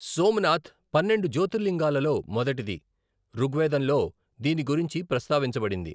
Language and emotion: Telugu, neutral